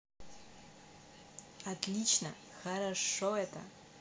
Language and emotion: Russian, positive